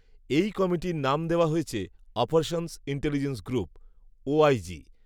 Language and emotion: Bengali, neutral